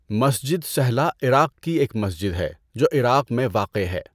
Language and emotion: Urdu, neutral